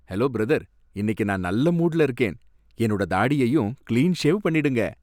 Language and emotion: Tamil, happy